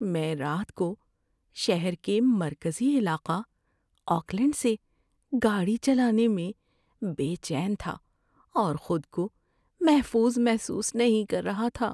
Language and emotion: Urdu, fearful